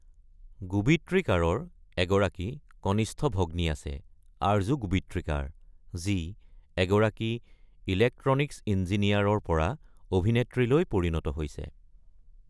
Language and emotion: Assamese, neutral